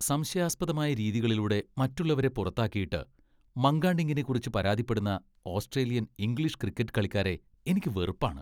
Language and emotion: Malayalam, disgusted